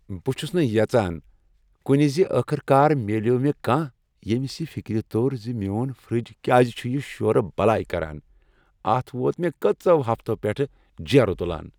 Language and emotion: Kashmiri, happy